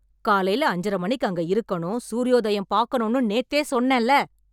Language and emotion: Tamil, angry